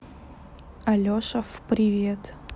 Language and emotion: Russian, neutral